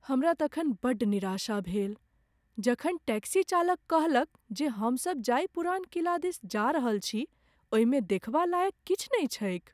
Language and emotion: Maithili, sad